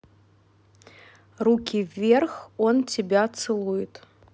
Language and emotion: Russian, neutral